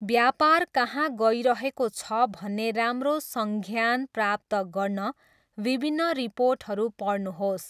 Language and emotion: Nepali, neutral